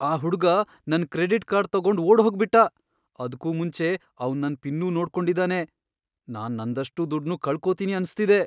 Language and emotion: Kannada, fearful